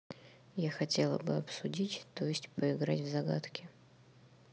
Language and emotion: Russian, neutral